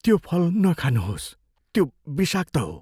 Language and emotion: Nepali, fearful